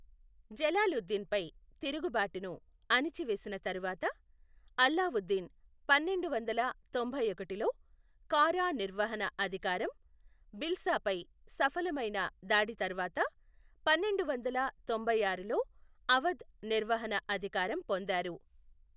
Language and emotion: Telugu, neutral